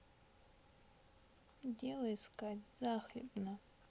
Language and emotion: Russian, sad